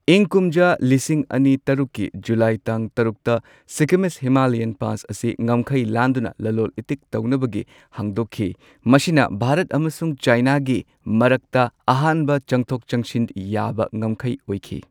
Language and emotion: Manipuri, neutral